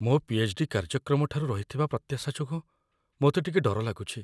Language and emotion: Odia, fearful